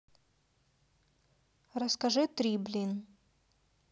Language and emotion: Russian, neutral